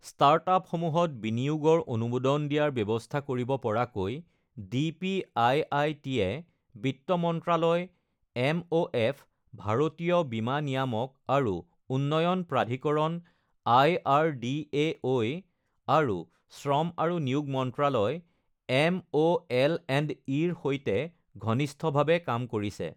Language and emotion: Assamese, neutral